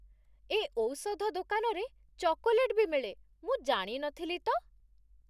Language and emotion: Odia, surprised